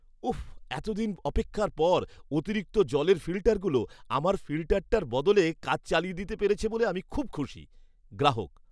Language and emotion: Bengali, happy